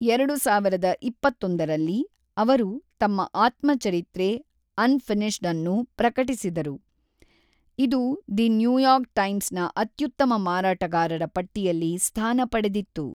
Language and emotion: Kannada, neutral